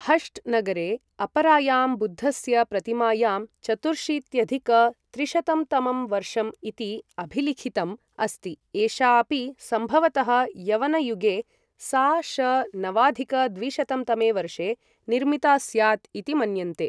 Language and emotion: Sanskrit, neutral